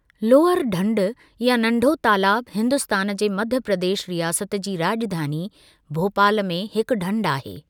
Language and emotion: Sindhi, neutral